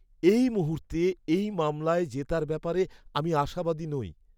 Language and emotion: Bengali, sad